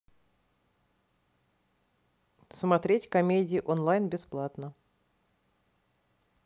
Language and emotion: Russian, neutral